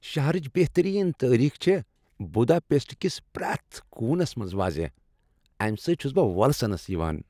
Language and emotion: Kashmiri, happy